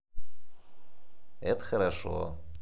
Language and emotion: Russian, positive